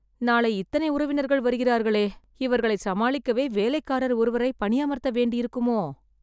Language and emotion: Tamil, sad